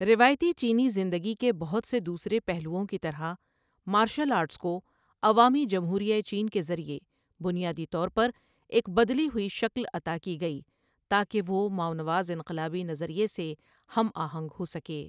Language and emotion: Urdu, neutral